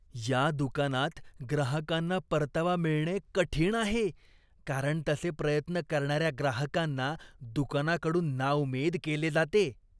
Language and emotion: Marathi, disgusted